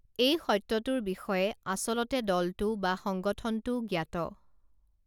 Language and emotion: Assamese, neutral